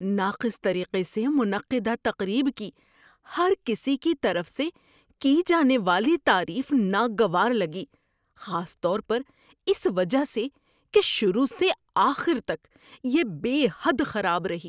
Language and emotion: Urdu, disgusted